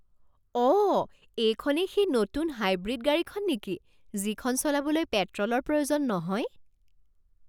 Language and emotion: Assamese, surprised